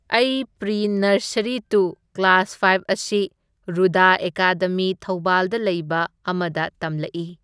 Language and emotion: Manipuri, neutral